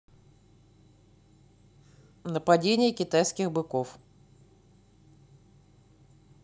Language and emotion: Russian, neutral